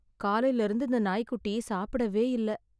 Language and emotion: Tamil, sad